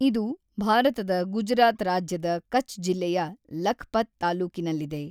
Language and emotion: Kannada, neutral